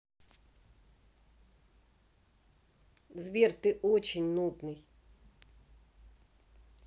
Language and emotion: Russian, angry